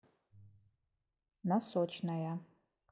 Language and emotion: Russian, neutral